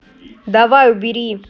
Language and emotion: Russian, angry